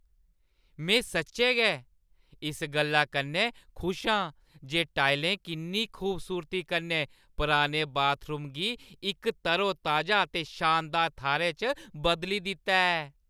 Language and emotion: Dogri, happy